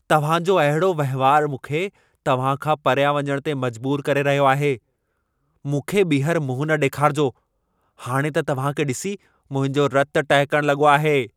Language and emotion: Sindhi, angry